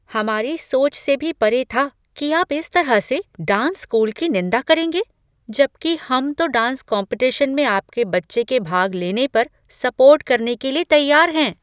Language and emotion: Hindi, surprised